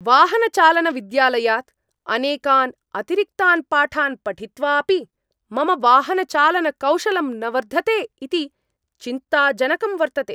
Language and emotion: Sanskrit, angry